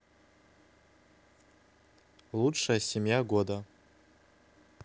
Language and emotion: Russian, neutral